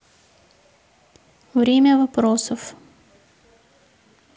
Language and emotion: Russian, neutral